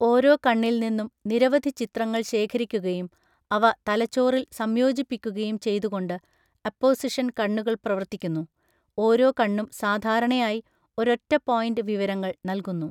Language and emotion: Malayalam, neutral